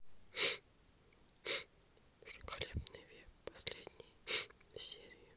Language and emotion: Russian, sad